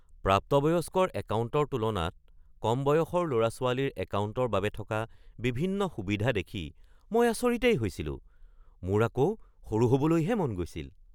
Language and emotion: Assamese, surprised